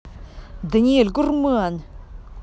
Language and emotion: Russian, angry